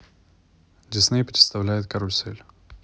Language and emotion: Russian, neutral